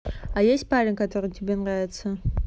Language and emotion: Russian, neutral